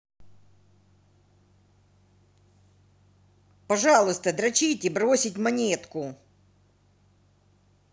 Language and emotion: Russian, angry